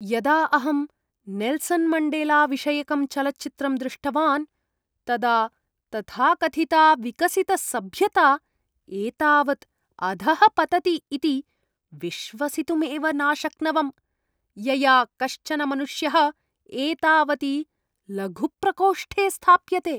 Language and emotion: Sanskrit, disgusted